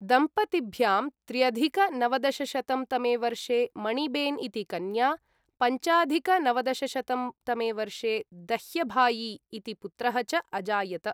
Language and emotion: Sanskrit, neutral